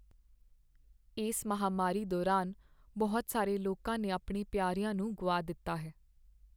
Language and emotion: Punjabi, sad